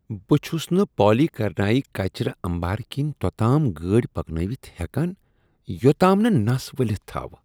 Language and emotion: Kashmiri, disgusted